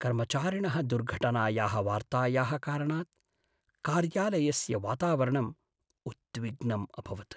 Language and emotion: Sanskrit, sad